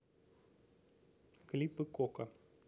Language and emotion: Russian, neutral